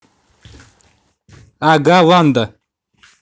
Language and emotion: Russian, neutral